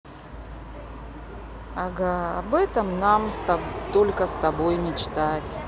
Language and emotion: Russian, sad